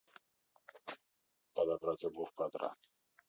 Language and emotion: Russian, neutral